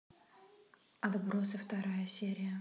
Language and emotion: Russian, neutral